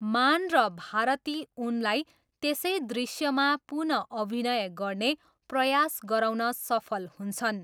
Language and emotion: Nepali, neutral